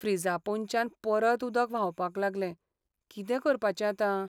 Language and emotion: Goan Konkani, sad